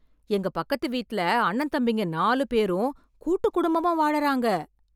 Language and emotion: Tamil, surprised